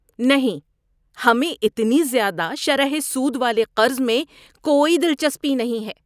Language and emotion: Urdu, disgusted